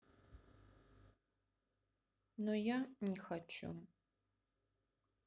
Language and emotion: Russian, sad